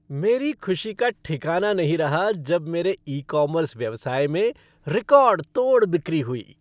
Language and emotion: Hindi, happy